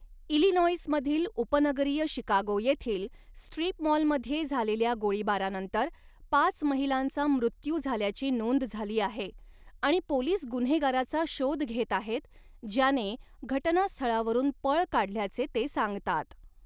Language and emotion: Marathi, neutral